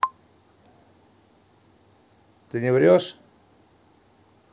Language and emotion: Russian, neutral